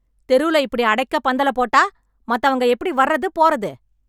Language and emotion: Tamil, angry